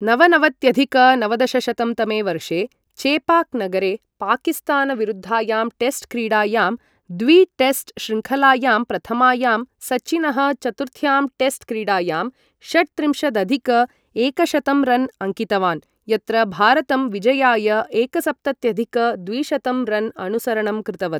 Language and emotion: Sanskrit, neutral